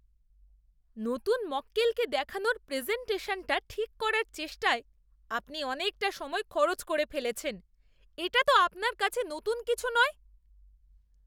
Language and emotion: Bengali, disgusted